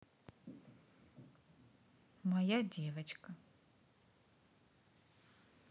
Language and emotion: Russian, neutral